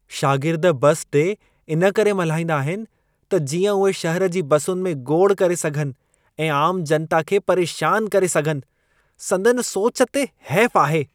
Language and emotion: Sindhi, disgusted